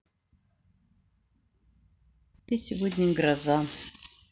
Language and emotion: Russian, neutral